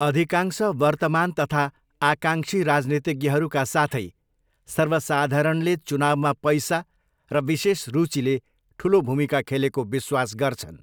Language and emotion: Nepali, neutral